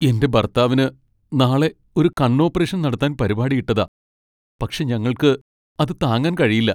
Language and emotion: Malayalam, sad